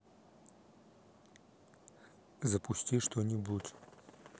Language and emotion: Russian, neutral